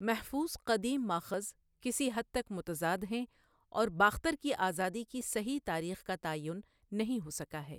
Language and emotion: Urdu, neutral